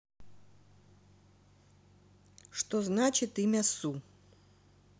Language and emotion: Russian, neutral